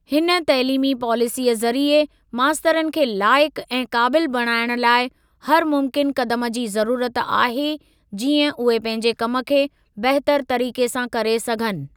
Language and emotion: Sindhi, neutral